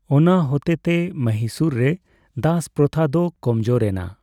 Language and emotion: Santali, neutral